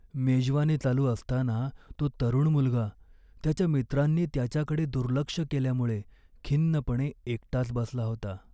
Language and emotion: Marathi, sad